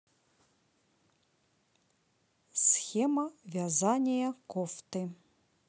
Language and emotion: Russian, neutral